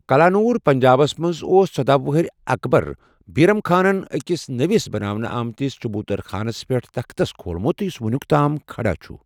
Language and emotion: Kashmiri, neutral